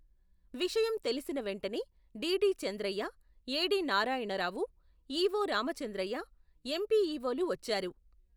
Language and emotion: Telugu, neutral